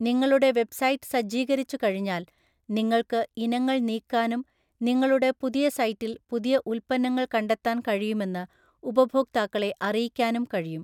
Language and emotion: Malayalam, neutral